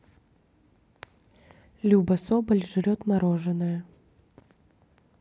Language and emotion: Russian, neutral